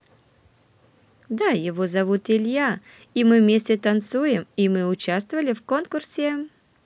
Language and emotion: Russian, positive